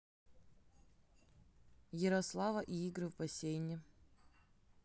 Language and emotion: Russian, neutral